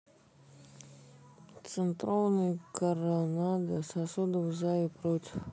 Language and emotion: Russian, neutral